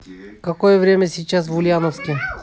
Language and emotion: Russian, neutral